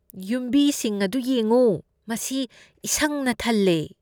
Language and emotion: Manipuri, disgusted